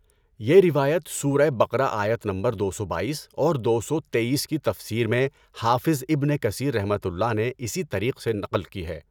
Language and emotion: Urdu, neutral